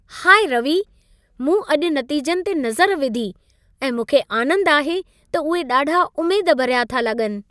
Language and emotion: Sindhi, happy